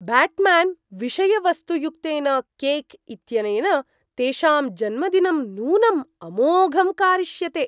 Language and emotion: Sanskrit, surprised